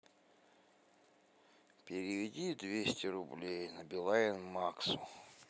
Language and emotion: Russian, sad